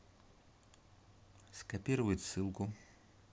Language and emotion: Russian, neutral